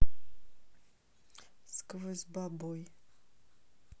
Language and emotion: Russian, neutral